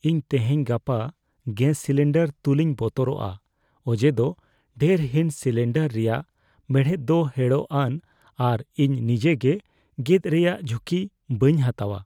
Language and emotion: Santali, fearful